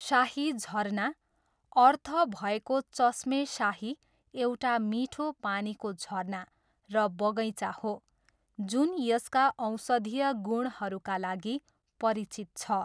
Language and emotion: Nepali, neutral